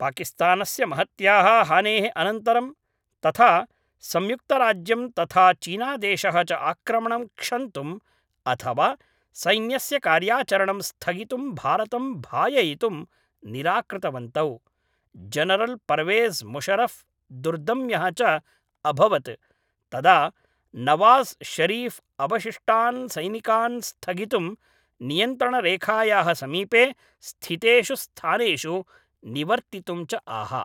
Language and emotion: Sanskrit, neutral